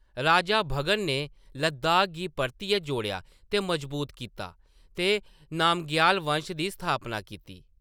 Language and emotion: Dogri, neutral